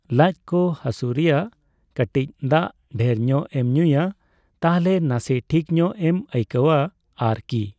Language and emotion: Santali, neutral